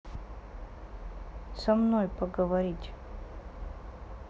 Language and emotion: Russian, neutral